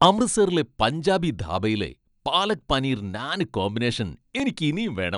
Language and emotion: Malayalam, happy